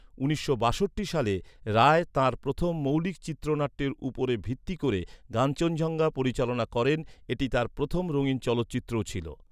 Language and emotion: Bengali, neutral